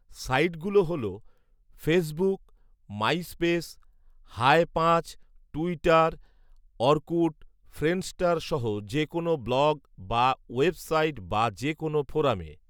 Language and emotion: Bengali, neutral